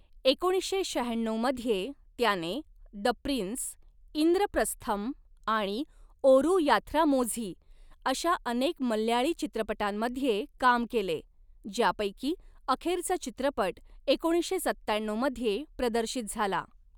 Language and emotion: Marathi, neutral